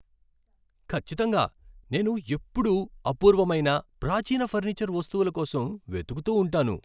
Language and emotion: Telugu, happy